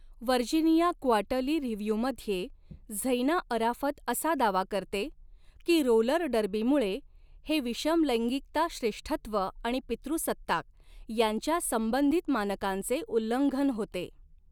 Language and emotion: Marathi, neutral